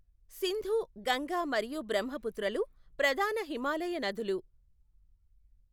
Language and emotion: Telugu, neutral